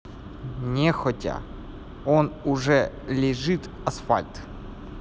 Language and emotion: Russian, neutral